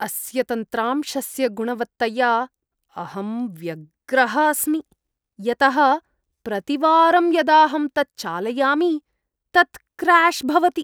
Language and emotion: Sanskrit, disgusted